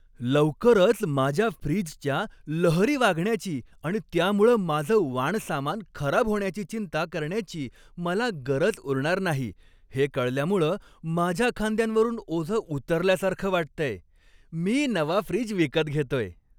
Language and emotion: Marathi, happy